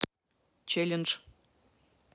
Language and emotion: Russian, neutral